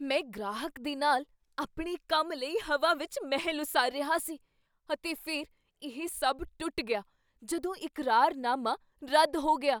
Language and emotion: Punjabi, surprised